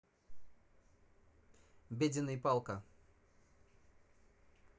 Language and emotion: Russian, neutral